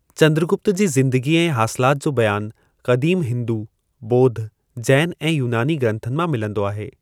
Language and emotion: Sindhi, neutral